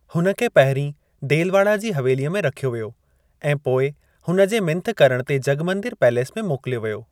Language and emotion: Sindhi, neutral